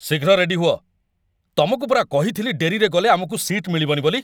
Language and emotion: Odia, angry